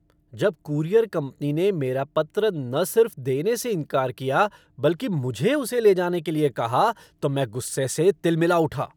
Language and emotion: Hindi, angry